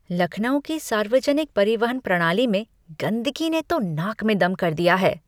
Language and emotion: Hindi, disgusted